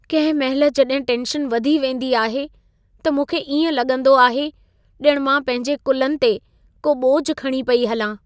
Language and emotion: Sindhi, sad